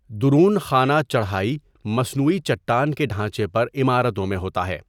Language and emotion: Urdu, neutral